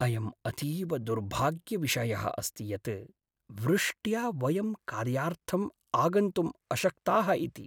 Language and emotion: Sanskrit, sad